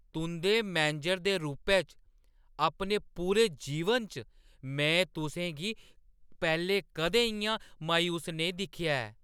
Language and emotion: Dogri, surprised